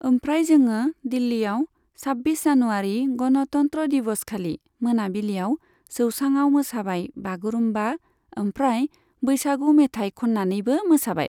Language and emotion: Bodo, neutral